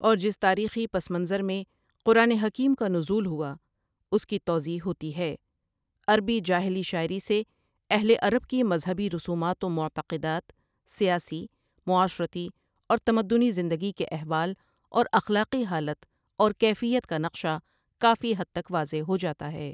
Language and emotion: Urdu, neutral